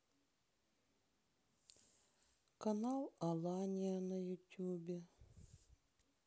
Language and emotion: Russian, sad